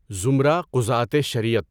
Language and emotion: Urdu, neutral